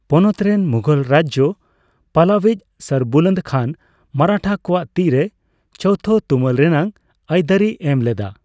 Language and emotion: Santali, neutral